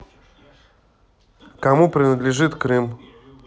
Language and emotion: Russian, neutral